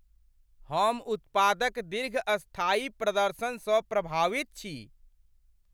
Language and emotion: Maithili, surprised